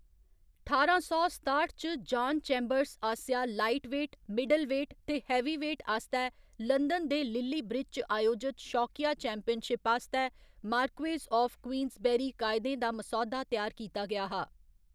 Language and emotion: Dogri, neutral